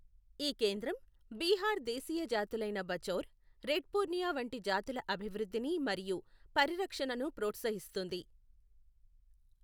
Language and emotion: Telugu, neutral